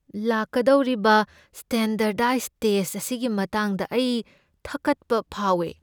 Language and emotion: Manipuri, fearful